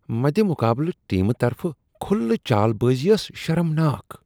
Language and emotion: Kashmiri, disgusted